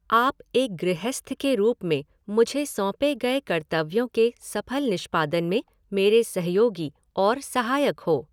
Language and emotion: Hindi, neutral